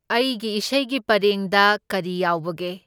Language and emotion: Manipuri, neutral